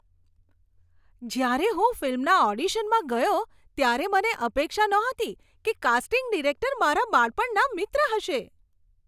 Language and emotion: Gujarati, surprised